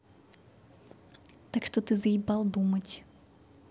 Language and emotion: Russian, angry